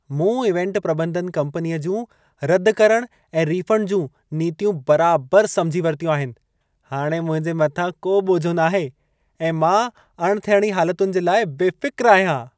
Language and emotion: Sindhi, happy